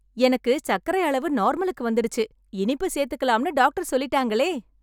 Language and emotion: Tamil, happy